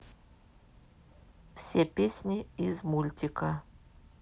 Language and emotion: Russian, neutral